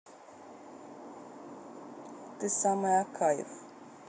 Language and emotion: Russian, neutral